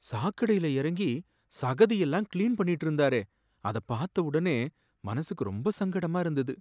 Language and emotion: Tamil, sad